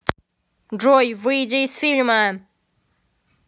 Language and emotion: Russian, angry